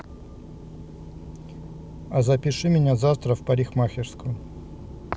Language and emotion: Russian, neutral